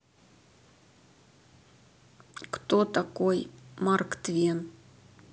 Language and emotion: Russian, neutral